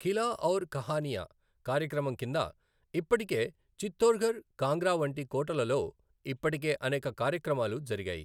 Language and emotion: Telugu, neutral